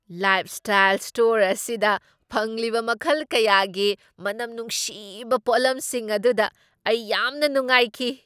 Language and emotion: Manipuri, surprised